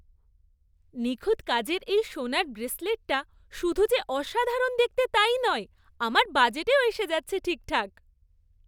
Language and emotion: Bengali, happy